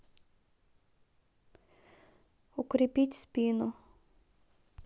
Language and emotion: Russian, neutral